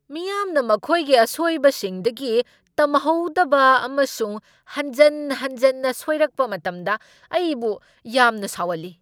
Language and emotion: Manipuri, angry